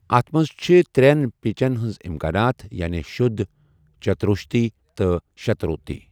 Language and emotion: Kashmiri, neutral